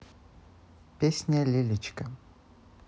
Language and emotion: Russian, neutral